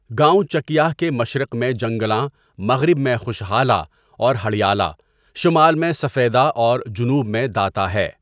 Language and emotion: Urdu, neutral